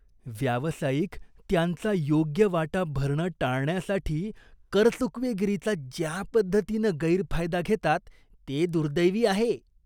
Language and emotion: Marathi, disgusted